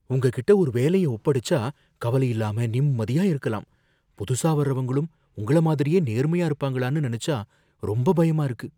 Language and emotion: Tamil, fearful